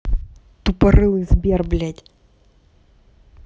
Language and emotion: Russian, angry